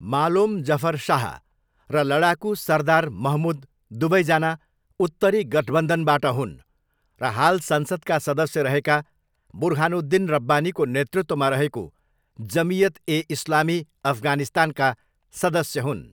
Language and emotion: Nepali, neutral